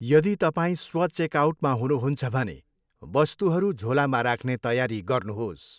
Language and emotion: Nepali, neutral